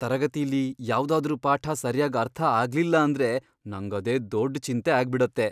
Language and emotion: Kannada, fearful